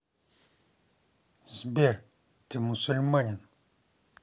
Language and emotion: Russian, angry